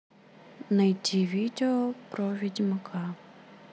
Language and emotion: Russian, neutral